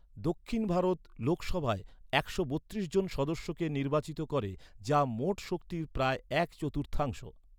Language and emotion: Bengali, neutral